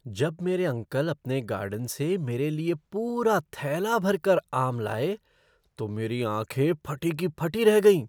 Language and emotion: Hindi, surprised